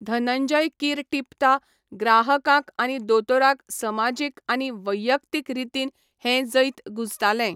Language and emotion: Goan Konkani, neutral